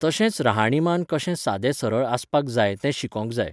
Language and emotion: Goan Konkani, neutral